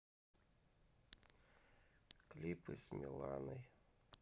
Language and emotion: Russian, sad